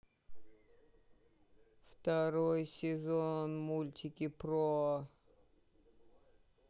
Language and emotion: Russian, sad